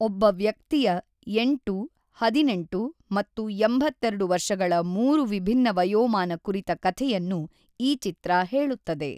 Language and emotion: Kannada, neutral